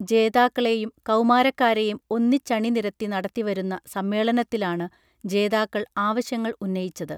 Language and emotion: Malayalam, neutral